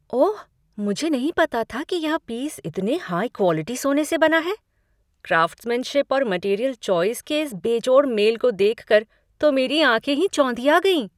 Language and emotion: Hindi, surprised